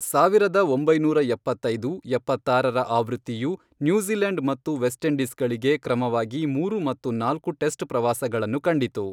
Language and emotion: Kannada, neutral